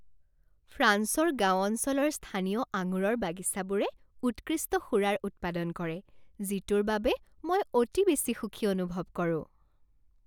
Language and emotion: Assamese, happy